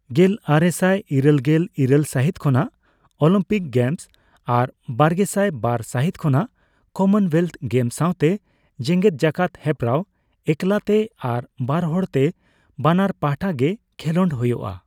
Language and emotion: Santali, neutral